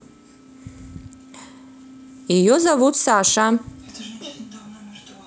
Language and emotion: Russian, neutral